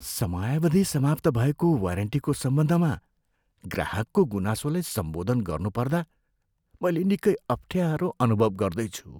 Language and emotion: Nepali, fearful